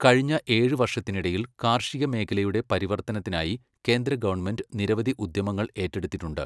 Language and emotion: Malayalam, neutral